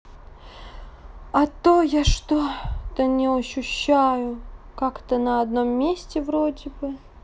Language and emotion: Russian, sad